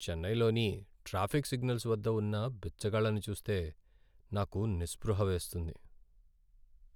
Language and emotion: Telugu, sad